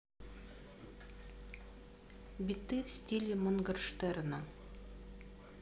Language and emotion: Russian, neutral